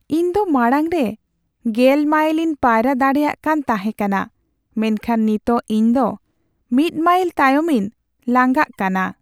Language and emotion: Santali, sad